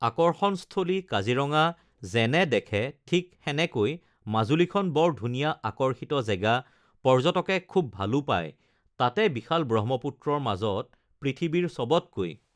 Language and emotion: Assamese, neutral